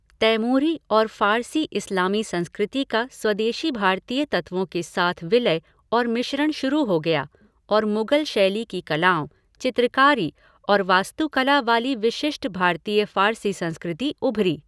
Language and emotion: Hindi, neutral